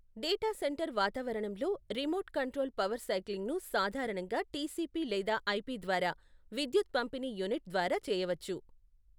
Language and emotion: Telugu, neutral